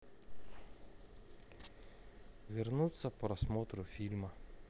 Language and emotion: Russian, neutral